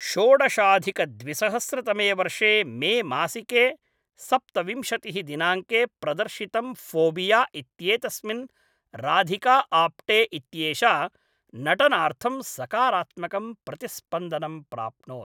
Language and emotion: Sanskrit, neutral